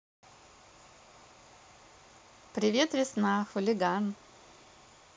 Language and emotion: Russian, positive